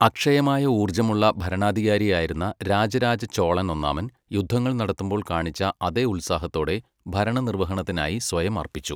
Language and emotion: Malayalam, neutral